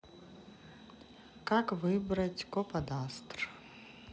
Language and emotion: Russian, neutral